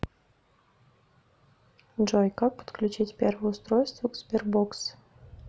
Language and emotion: Russian, neutral